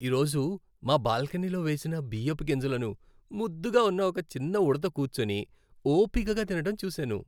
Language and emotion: Telugu, happy